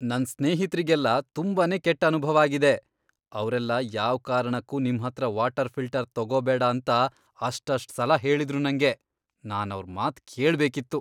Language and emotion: Kannada, disgusted